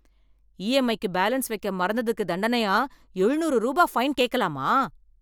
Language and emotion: Tamil, angry